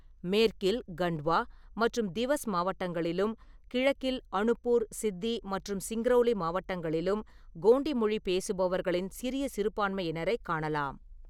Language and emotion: Tamil, neutral